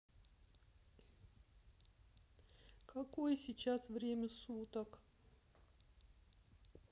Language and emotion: Russian, sad